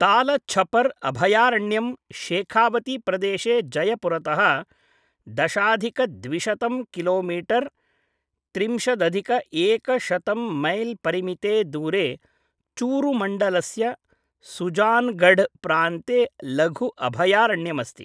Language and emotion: Sanskrit, neutral